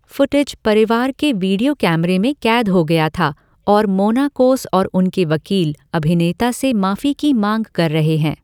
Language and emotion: Hindi, neutral